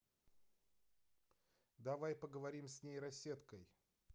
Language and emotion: Russian, neutral